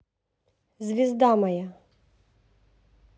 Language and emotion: Russian, neutral